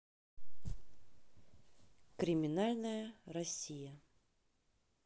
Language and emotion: Russian, neutral